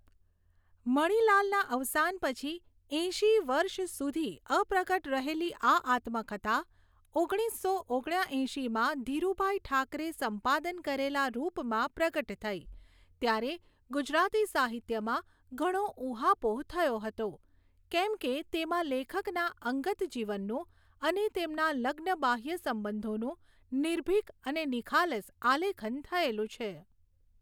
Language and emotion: Gujarati, neutral